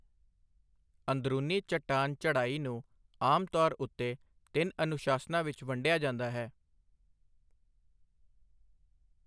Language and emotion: Punjabi, neutral